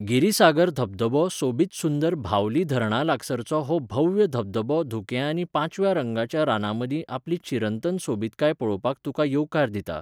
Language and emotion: Goan Konkani, neutral